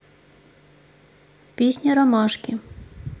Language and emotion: Russian, neutral